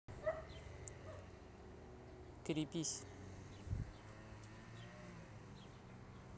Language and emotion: Russian, neutral